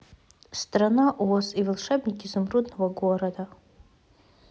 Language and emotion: Russian, neutral